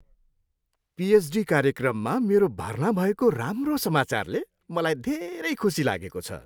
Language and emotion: Nepali, happy